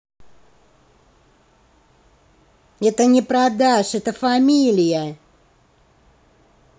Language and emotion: Russian, angry